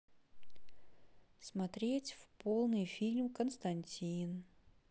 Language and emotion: Russian, neutral